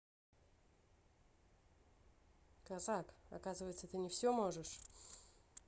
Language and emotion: Russian, angry